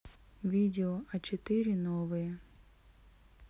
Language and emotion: Russian, neutral